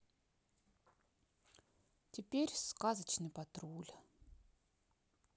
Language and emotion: Russian, neutral